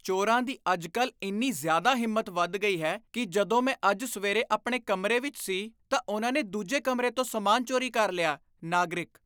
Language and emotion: Punjabi, disgusted